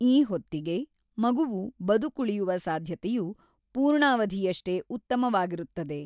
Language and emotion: Kannada, neutral